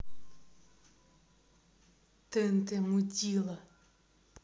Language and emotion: Russian, angry